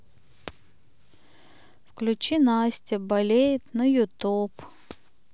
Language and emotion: Russian, sad